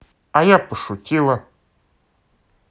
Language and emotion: Russian, positive